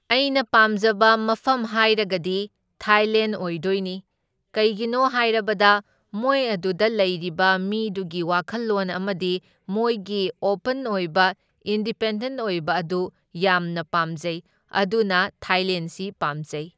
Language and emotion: Manipuri, neutral